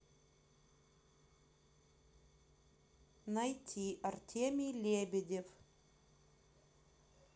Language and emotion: Russian, neutral